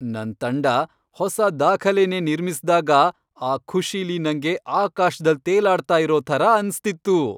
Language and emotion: Kannada, happy